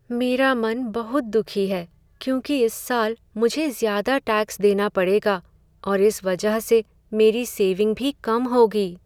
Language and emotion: Hindi, sad